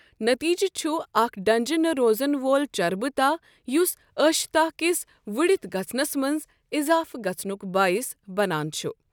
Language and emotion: Kashmiri, neutral